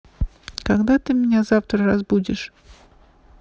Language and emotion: Russian, neutral